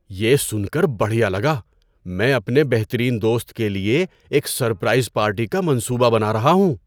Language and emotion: Urdu, surprised